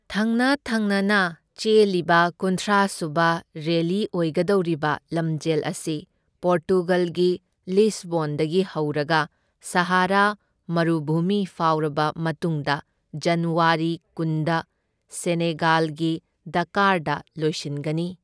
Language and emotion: Manipuri, neutral